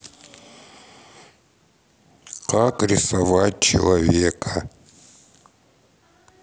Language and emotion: Russian, neutral